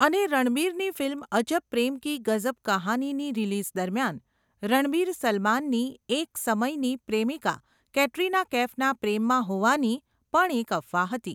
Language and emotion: Gujarati, neutral